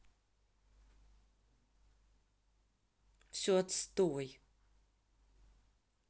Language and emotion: Russian, angry